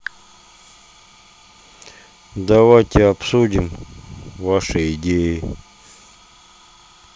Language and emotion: Russian, neutral